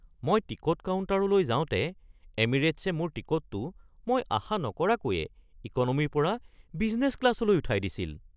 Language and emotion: Assamese, surprised